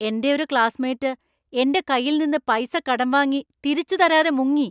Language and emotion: Malayalam, angry